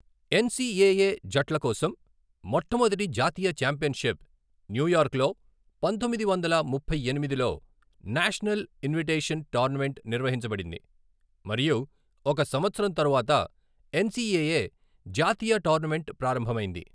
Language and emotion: Telugu, neutral